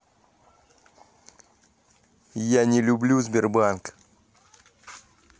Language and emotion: Russian, angry